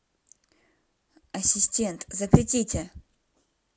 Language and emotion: Russian, neutral